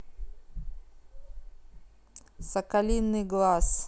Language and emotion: Russian, neutral